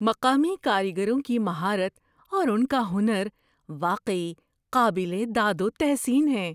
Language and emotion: Urdu, surprised